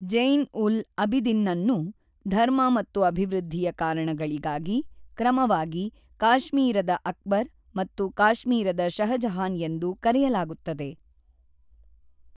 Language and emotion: Kannada, neutral